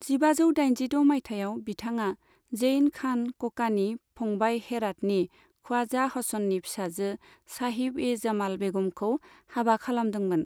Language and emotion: Bodo, neutral